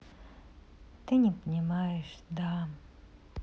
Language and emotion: Russian, sad